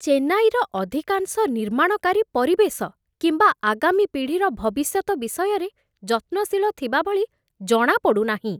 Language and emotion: Odia, disgusted